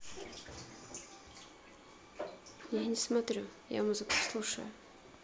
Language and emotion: Russian, neutral